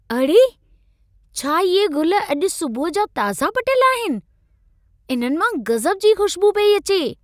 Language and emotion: Sindhi, surprised